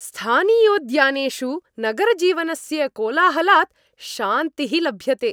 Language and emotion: Sanskrit, happy